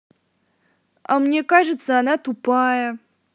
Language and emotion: Russian, angry